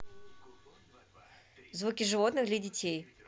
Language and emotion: Russian, neutral